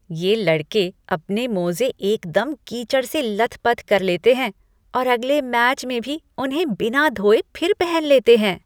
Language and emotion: Hindi, disgusted